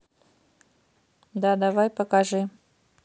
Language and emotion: Russian, neutral